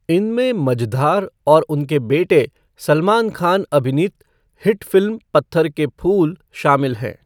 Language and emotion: Hindi, neutral